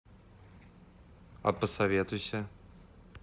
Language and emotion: Russian, neutral